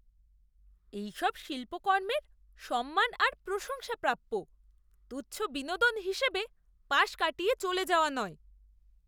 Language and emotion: Bengali, disgusted